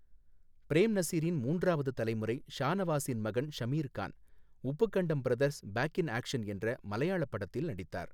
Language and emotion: Tamil, neutral